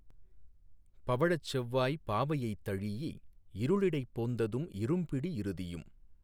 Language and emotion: Tamil, neutral